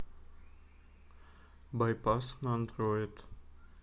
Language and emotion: Russian, neutral